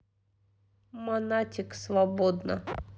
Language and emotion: Russian, neutral